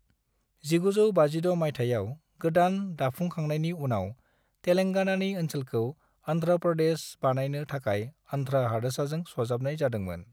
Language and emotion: Bodo, neutral